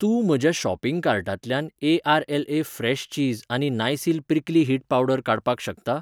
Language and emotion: Goan Konkani, neutral